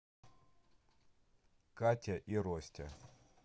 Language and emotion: Russian, neutral